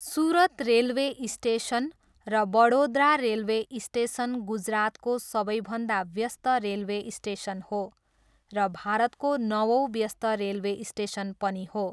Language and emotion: Nepali, neutral